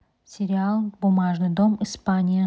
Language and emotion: Russian, neutral